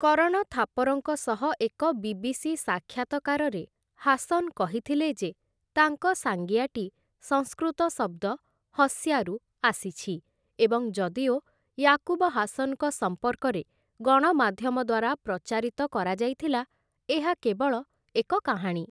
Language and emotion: Odia, neutral